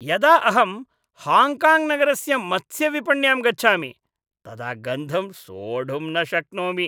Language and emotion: Sanskrit, disgusted